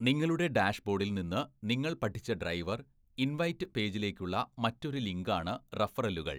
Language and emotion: Malayalam, neutral